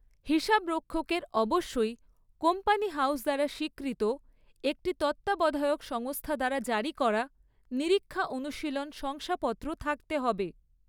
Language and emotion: Bengali, neutral